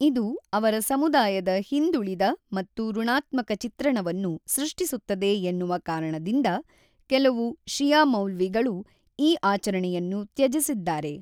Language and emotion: Kannada, neutral